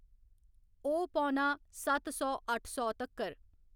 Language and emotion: Dogri, neutral